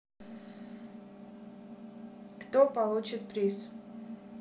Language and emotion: Russian, neutral